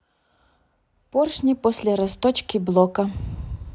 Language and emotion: Russian, neutral